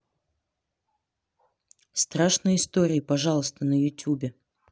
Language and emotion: Russian, neutral